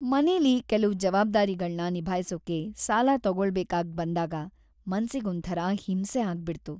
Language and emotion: Kannada, sad